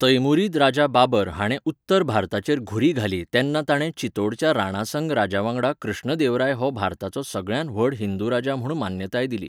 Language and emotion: Goan Konkani, neutral